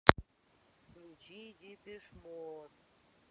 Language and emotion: Russian, neutral